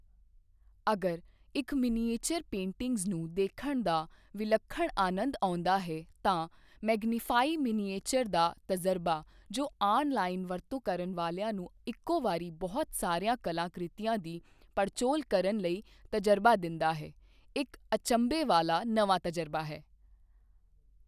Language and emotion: Punjabi, neutral